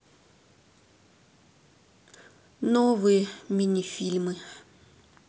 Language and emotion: Russian, sad